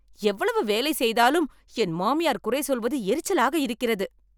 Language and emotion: Tamil, angry